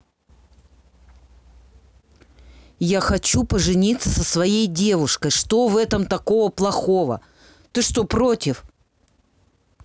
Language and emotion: Russian, angry